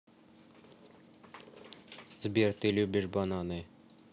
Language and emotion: Russian, neutral